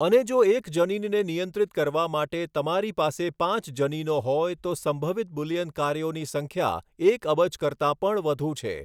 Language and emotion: Gujarati, neutral